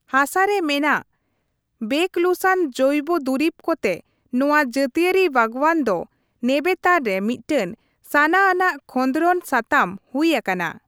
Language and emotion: Santali, neutral